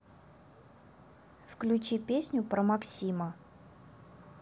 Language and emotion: Russian, neutral